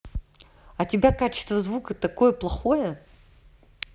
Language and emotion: Russian, neutral